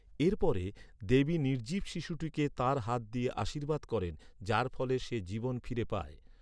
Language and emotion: Bengali, neutral